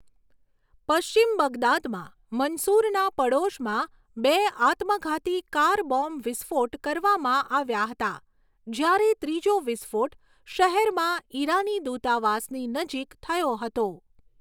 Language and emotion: Gujarati, neutral